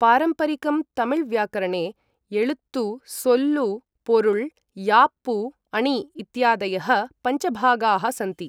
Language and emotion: Sanskrit, neutral